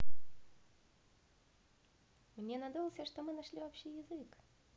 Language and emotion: Russian, positive